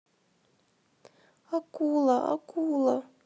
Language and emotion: Russian, sad